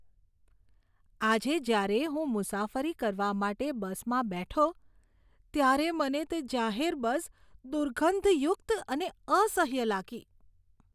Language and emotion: Gujarati, disgusted